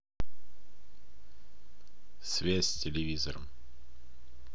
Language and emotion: Russian, neutral